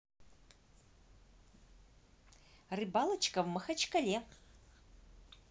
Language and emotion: Russian, positive